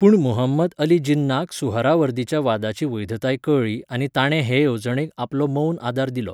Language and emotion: Goan Konkani, neutral